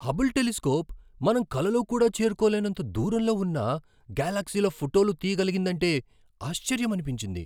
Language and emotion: Telugu, surprised